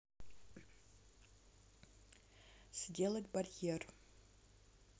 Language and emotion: Russian, neutral